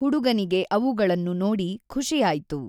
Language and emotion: Kannada, neutral